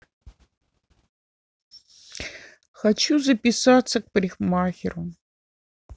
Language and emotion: Russian, sad